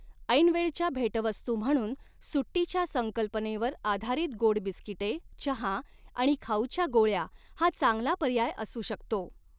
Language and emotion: Marathi, neutral